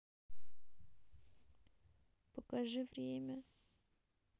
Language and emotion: Russian, sad